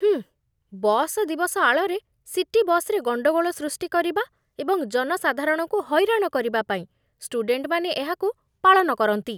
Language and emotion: Odia, disgusted